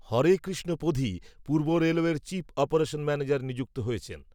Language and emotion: Bengali, neutral